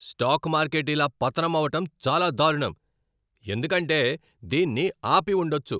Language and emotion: Telugu, angry